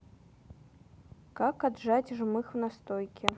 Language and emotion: Russian, neutral